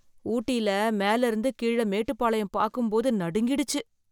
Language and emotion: Tamil, fearful